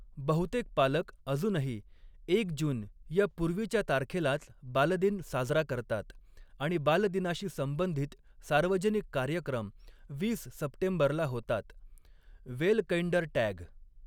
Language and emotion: Marathi, neutral